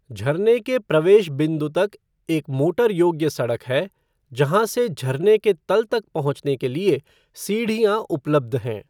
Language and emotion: Hindi, neutral